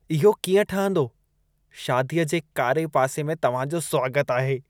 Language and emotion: Sindhi, disgusted